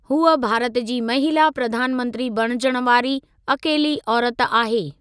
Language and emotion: Sindhi, neutral